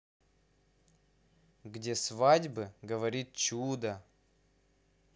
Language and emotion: Russian, positive